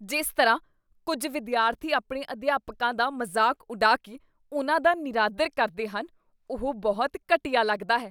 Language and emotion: Punjabi, disgusted